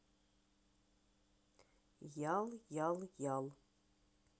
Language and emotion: Russian, neutral